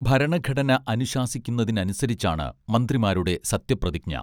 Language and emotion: Malayalam, neutral